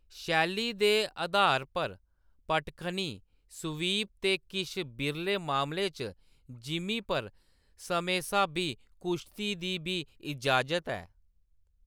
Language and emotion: Dogri, neutral